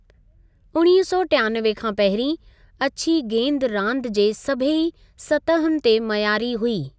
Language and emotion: Sindhi, neutral